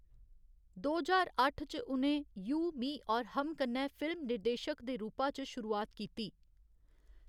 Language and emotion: Dogri, neutral